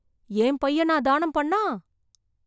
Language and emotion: Tamil, surprised